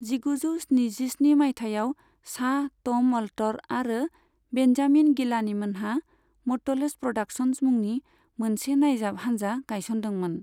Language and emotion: Bodo, neutral